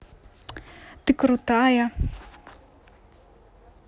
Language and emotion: Russian, positive